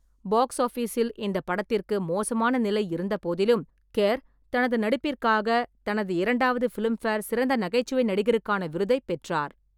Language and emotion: Tamil, neutral